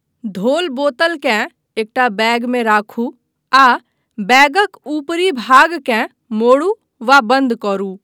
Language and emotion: Maithili, neutral